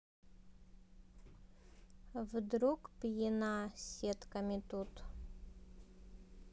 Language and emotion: Russian, neutral